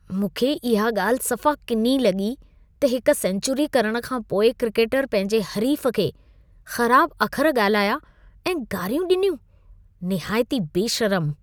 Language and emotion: Sindhi, disgusted